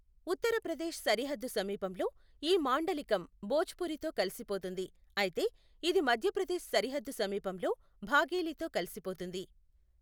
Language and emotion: Telugu, neutral